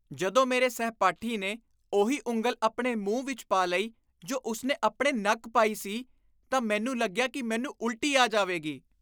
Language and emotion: Punjabi, disgusted